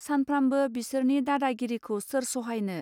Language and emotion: Bodo, neutral